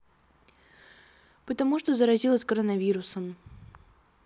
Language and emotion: Russian, sad